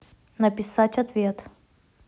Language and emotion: Russian, neutral